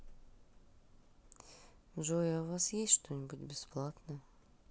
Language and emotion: Russian, sad